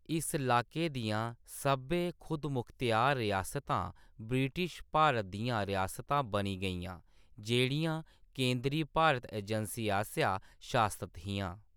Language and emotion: Dogri, neutral